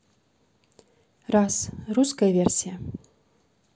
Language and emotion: Russian, neutral